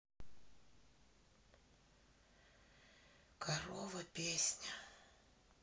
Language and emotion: Russian, sad